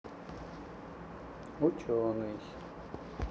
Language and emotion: Russian, neutral